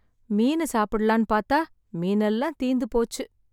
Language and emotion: Tamil, sad